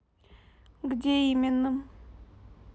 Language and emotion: Russian, neutral